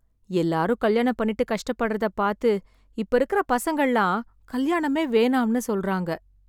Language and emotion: Tamil, sad